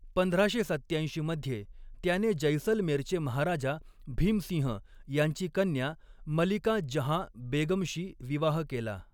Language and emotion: Marathi, neutral